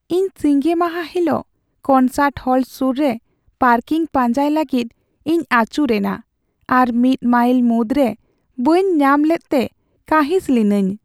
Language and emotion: Santali, sad